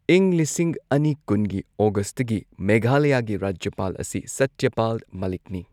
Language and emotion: Manipuri, neutral